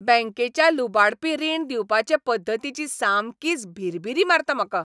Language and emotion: Goan Konkani, angry